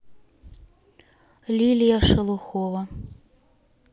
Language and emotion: Russian, neutral